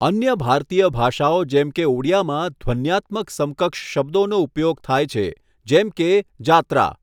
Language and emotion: Gujarati, neutral